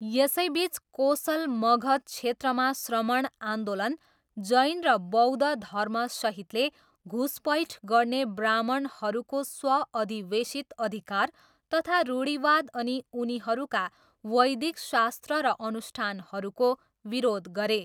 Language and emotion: Nepali, neutral